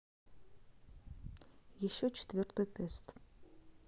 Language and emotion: Russian, neutral